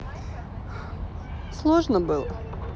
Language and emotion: Russian, neutral